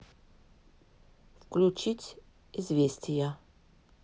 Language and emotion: Russian, neutral